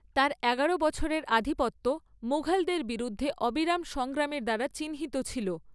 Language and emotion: Bengali, neutral